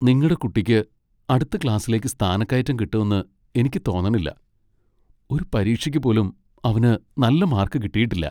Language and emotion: Malayalam, sad